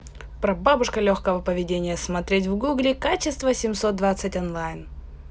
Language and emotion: Russian, positive